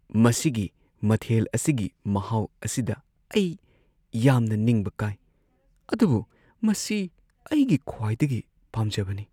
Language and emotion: Manipuri, sad